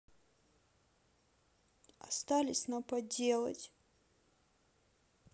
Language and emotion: Russian, sad